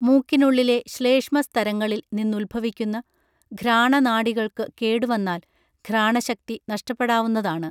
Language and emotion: Malayalam, neutral